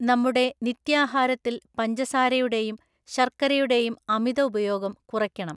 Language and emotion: Malayalam, neutral